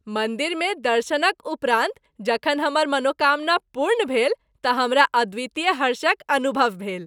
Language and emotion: Maithili, happy